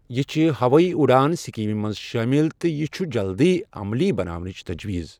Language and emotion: Kashmiri, neutral